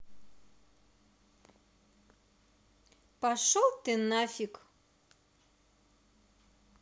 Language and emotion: Russian, angry